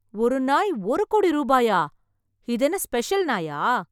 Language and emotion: Tamil, surprised